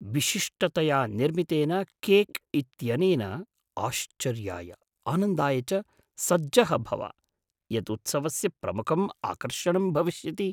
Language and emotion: Sanskrit, surprised